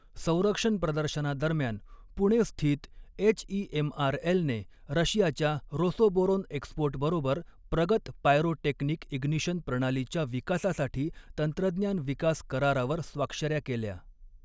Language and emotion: Marathi, neutral